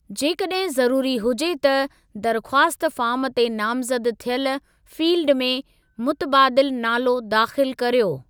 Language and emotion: Sindhi, neutral